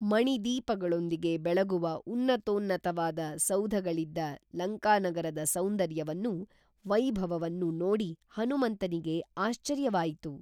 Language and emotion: Kannada, neutral